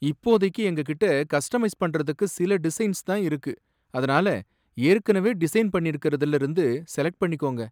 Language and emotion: Tamil, sad